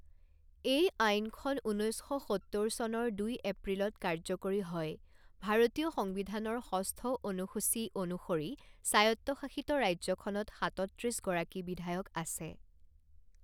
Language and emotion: Assamese, neutral